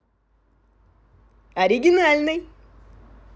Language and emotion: Russian, positive